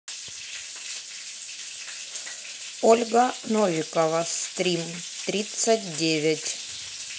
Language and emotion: Russian, neutral